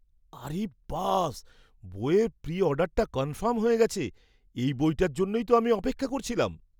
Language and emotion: Bengali, surprised